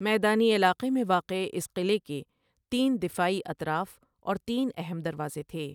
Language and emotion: Urdu, neutral